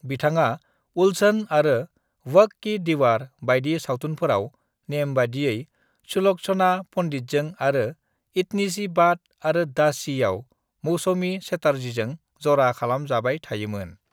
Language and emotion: Bodo, neutral